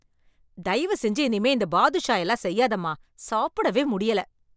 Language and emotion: Tamil, angry